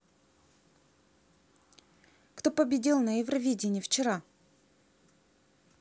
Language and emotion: Russian, neutral